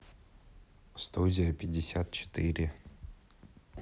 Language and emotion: Russian, neutral